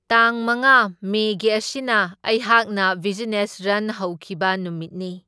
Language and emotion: Manipuri, neutral